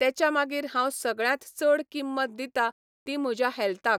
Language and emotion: Goan Konkani, neutral